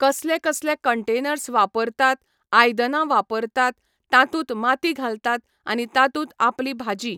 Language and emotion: Goan Konkani, neutral